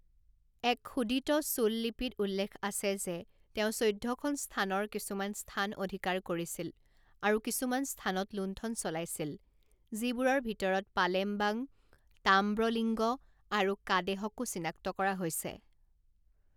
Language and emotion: Assamese, neutral